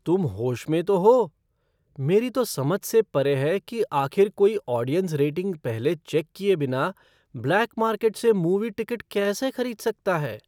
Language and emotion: Hindi, surprised